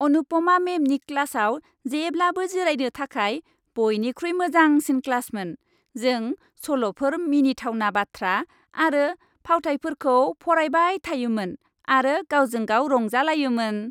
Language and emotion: Bodo, happy